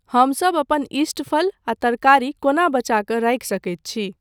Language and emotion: Maithili, neutral